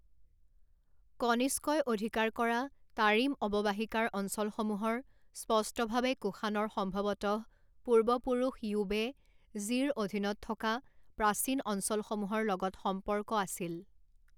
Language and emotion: Assamese, neutral